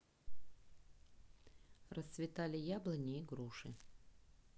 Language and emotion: Russian, neutral